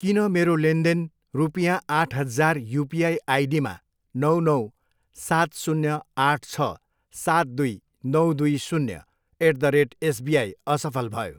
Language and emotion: Nepali, neutral